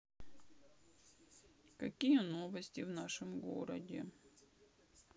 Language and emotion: Russian, sad